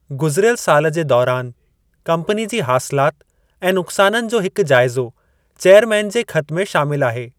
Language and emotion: Sindhi, neutral